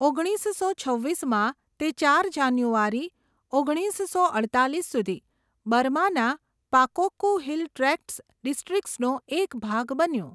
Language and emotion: Gujarati, neutral